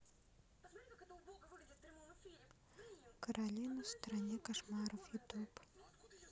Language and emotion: Russian, neutral